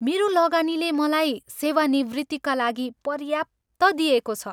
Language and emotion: Nepali, happy